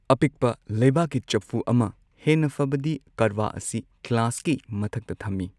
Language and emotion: Manipuri, neutral